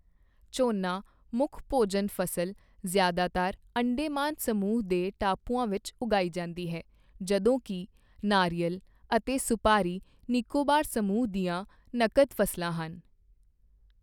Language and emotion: Punjabi, neutral